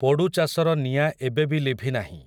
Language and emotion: Odia, neutral